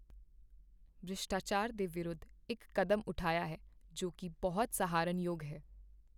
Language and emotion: Punjabi, neutral